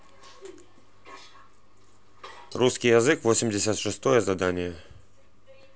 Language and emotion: Russian, neutral